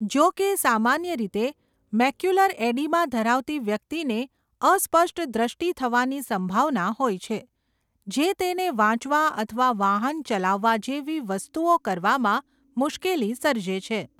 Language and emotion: Gujarati, neutral